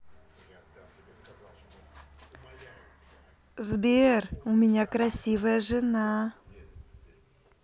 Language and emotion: Russian, positive